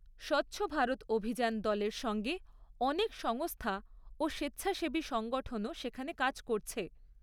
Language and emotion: Bengali, neutral